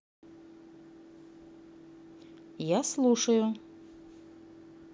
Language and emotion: Russian, neutral